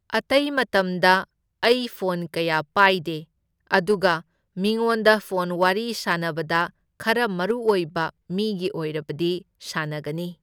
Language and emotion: Manipuri, neutral